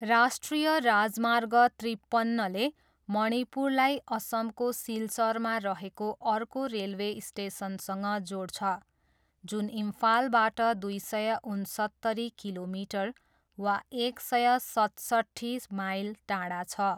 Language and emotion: Nepali, neutral